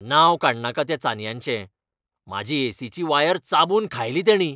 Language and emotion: Goan Konkani, angry